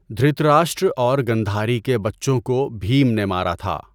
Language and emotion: Urdu, neutral